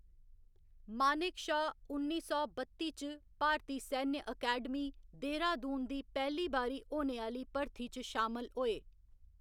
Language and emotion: Dogri, neutral